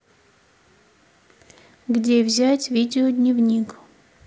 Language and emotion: Russian, neutral